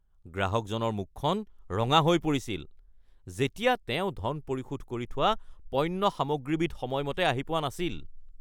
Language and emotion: Assamese, angry